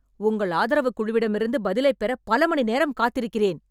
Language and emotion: Tamil, angry